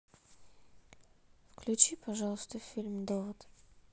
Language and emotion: Russian, neutral